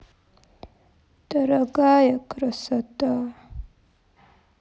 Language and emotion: Russian, sad